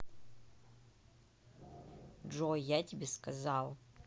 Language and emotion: Russian, angry